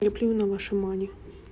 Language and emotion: Russian, neutral